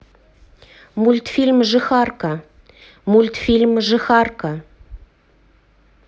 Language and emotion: Russian, neutral